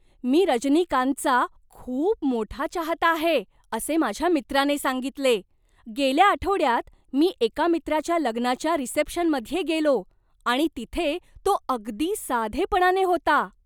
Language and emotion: Marathi, surprised